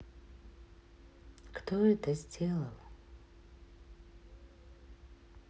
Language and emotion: Russian, neutral